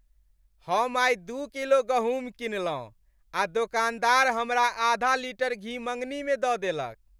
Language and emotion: Maithili, happy